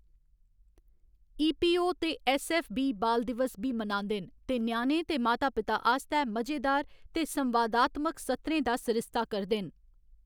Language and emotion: Dogri, neutral